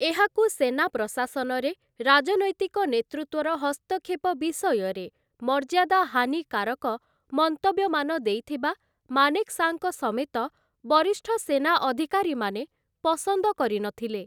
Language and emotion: Odia, neutral